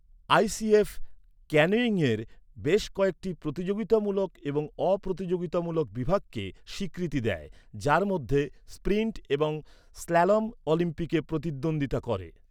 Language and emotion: Bengali, neutral